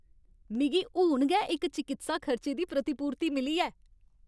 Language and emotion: Dogri, happy